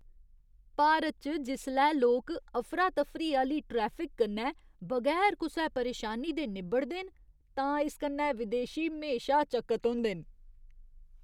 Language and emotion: Dogri, surprised